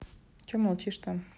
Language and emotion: Russian, neutral